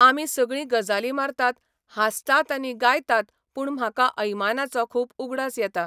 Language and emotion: Goan Konkani, neutral